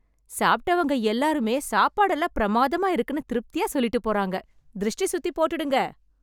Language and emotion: Tamil, happy